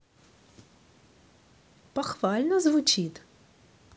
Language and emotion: Russian, positive